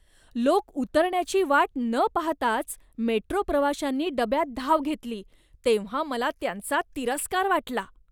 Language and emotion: Marathi, disgusted